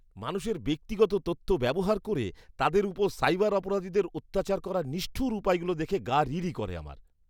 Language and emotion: Bengali, disgusted